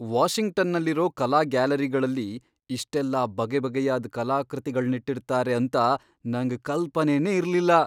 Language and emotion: Kannada, surprised